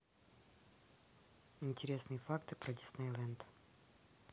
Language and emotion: Russian, neutral